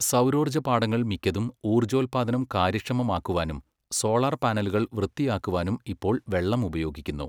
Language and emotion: Malayalam, neutral